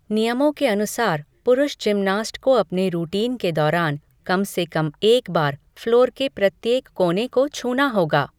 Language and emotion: Hindi, neutral